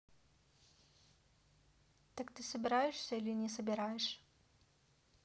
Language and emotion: Russian, neutral